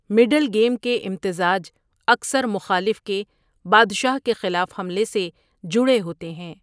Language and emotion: Urdu, neutral